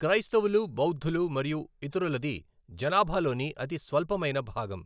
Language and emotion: Telugu, neutral